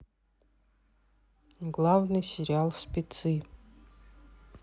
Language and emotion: Russian, neutral